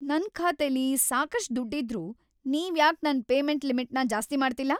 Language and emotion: Kannada, angry